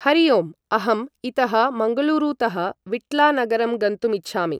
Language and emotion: Sanskrit, neutral